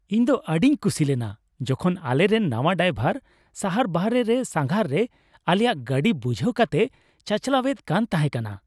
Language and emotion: Santali, happy